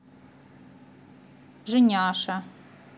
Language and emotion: Russian, neutral